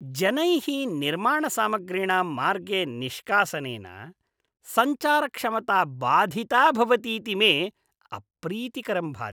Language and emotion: Sanskrit, disgusted